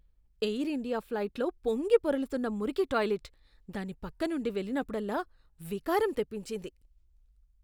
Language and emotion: Telugu, disgusted